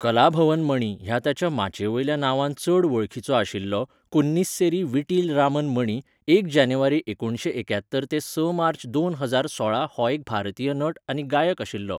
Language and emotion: Goan Konkani, neutral